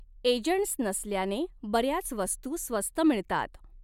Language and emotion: Marathi, neutral